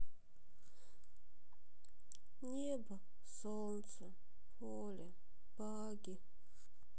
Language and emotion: Russian, sad